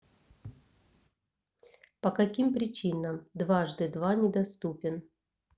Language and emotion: Russian, neutral